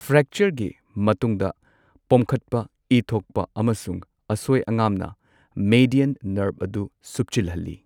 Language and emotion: Manipuri, neutral